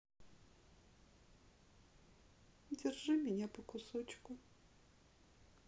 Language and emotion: Russian, sad